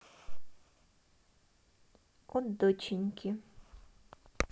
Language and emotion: Russian, neutral